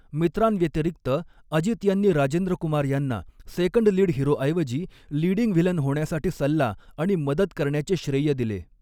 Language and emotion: Marathi, neutral